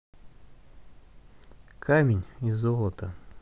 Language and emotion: Russian, neutral